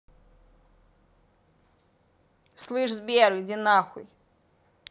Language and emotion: Russian, angry